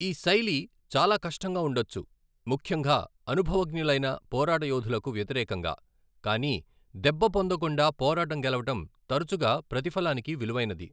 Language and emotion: Telugu, neutral